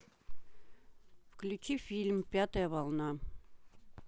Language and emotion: Russian, neutral